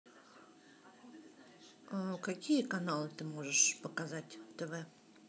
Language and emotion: Russian, neutral